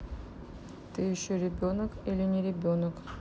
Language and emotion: Russian, neutral